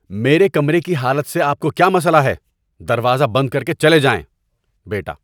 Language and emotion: Urdu, angry